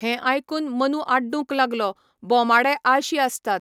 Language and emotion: Goan Konkani, neutral